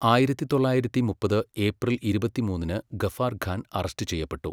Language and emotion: Malayalam, neutral